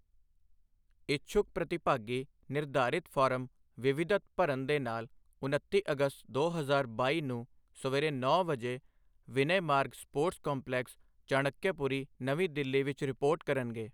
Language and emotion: Punjabi, neutral